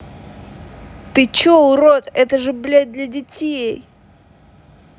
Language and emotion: Russian, angry